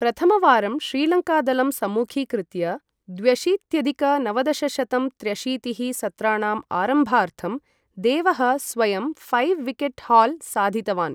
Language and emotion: Sanskrit, neutral